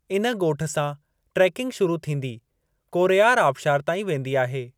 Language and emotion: Sindhi, neutral